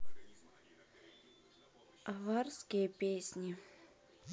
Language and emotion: Russian, neutral